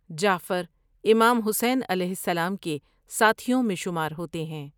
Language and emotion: Urdu, neutral